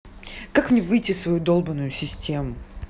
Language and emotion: Russian, angry